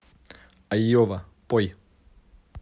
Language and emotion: Russian, neutral